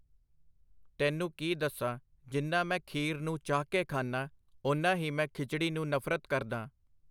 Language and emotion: Punjabi, neutral